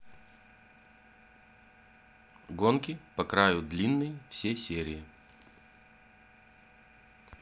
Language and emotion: Russian, neutral